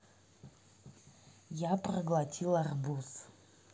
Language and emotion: Russian, neutral